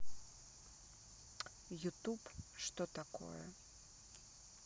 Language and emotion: Russian, neutral